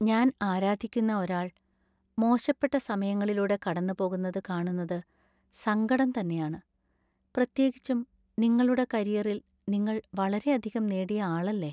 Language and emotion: Malayalam, sad